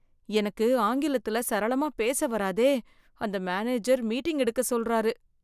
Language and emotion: Tamil, fearful